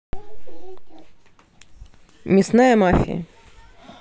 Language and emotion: Russian, neutral